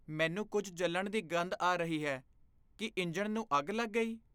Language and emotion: Punjabi, fearful